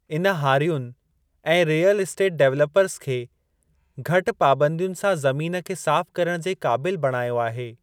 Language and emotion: Sindhi, neutral